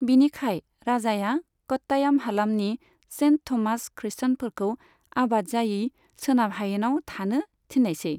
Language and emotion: Bodo, neutral